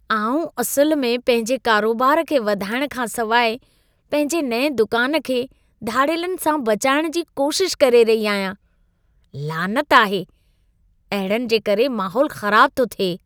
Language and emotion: Sindhi, disgusted